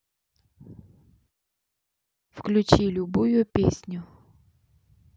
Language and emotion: Russian, neutral